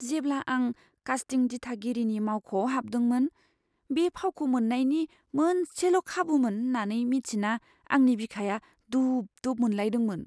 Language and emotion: Bodo, fearful